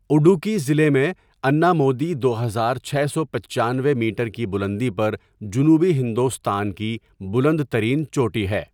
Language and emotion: Urdu, neutral